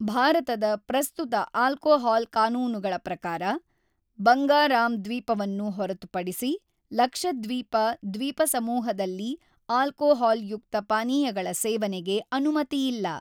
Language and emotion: Kannada, neutral